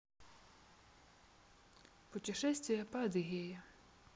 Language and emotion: Russian, neutral